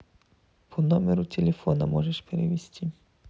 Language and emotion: Russian, neutral